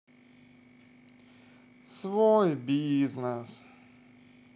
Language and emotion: Russian, sad